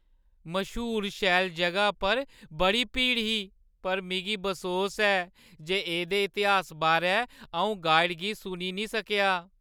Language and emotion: Dogri, sad